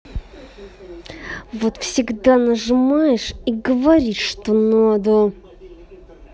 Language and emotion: Russian, angry